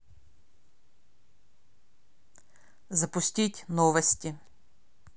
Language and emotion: Russian, neutral